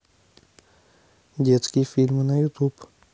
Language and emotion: Russian, neutral